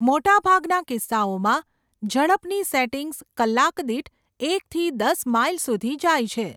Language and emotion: Gujarati, neutral